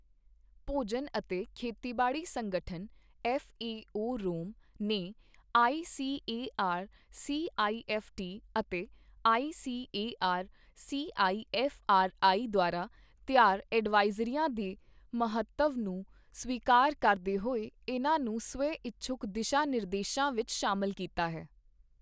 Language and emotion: Punjabi, neutral